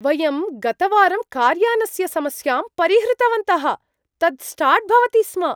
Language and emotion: Sanskrit, surprised